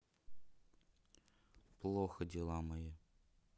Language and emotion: Russian, sad